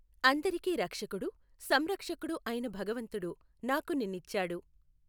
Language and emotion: Telugu, neutral